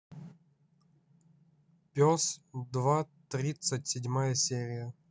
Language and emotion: Russian, neutral